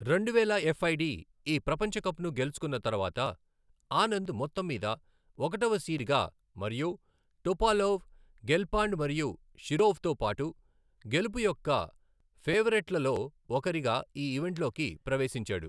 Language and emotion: Telugu, neutral